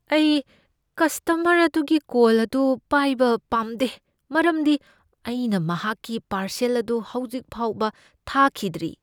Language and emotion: Manipuri, fearful